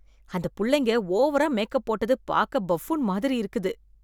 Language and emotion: Tamil, disgusted